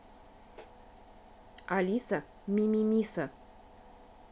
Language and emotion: Russian, neutral